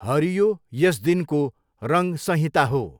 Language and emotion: Nepali, neutral